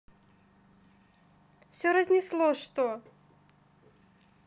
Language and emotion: Russian, neutral